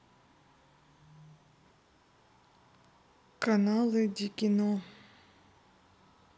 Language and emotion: Russian, neutral